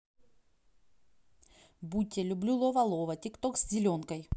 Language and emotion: Russian, neutral